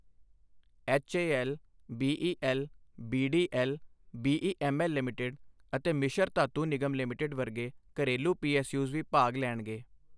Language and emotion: Punjabi, neutral